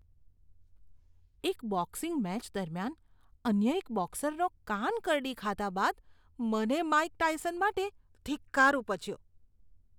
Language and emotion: Gujarati, disgusted